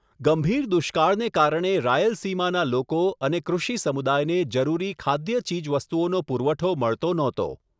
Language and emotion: Gujarati, neutral